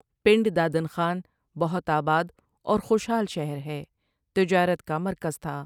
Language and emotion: Urdu, neutral